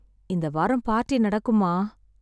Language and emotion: Tamil, sad